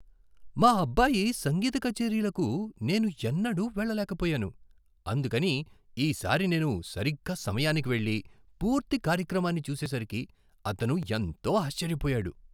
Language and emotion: Telugu, surprised